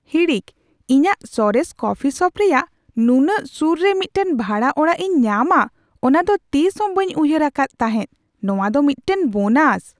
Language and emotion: Santali, surprised